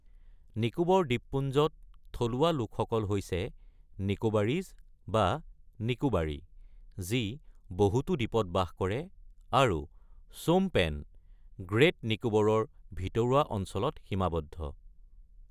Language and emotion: Assamese, neutral